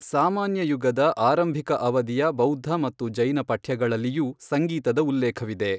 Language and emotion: Kannada, neutral